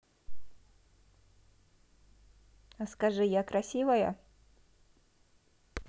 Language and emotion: Russian, positive